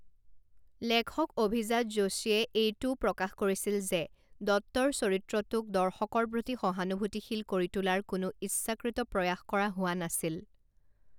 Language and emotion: Assamese, neutral